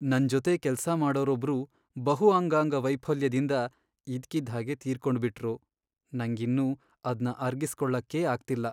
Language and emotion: Kannada, sad